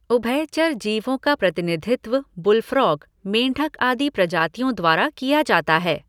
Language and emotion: Hindi, neutral